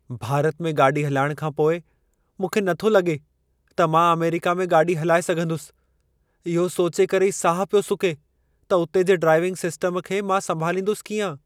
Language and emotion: Sindhi, fearful